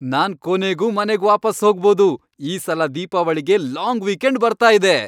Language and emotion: Kannada, happy